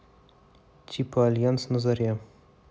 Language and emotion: Russian, neutral